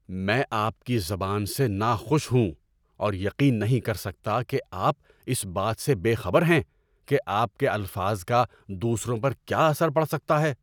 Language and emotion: Urdu, angry